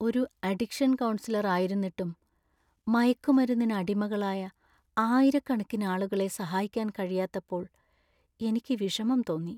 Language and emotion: Malayalam, sad